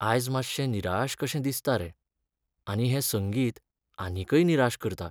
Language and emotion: Goan Konkani, sad